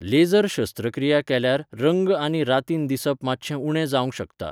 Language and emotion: Goan Konkani, neutral